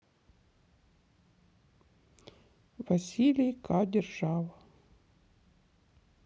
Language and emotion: Russian, sad